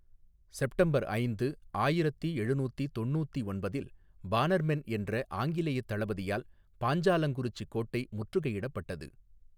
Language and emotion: Tamil, neutral